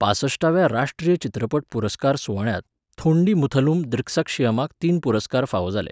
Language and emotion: Goan Konkani, neutral